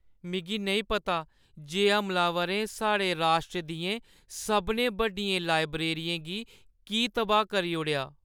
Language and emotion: Dogri, sad